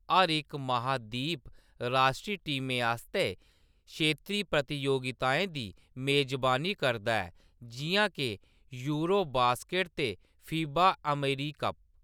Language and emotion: Dogri, neutral